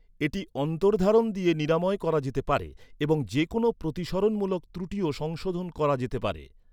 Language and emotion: Bengali, neutral